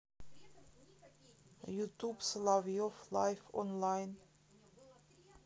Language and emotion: Russian, neutral